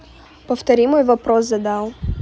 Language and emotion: Russian, neutral